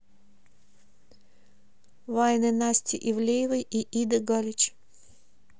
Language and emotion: Russian, neutral